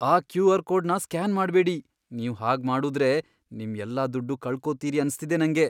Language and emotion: Kannada, fearful